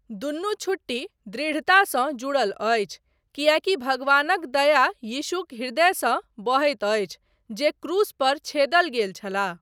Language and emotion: Maithili, neutral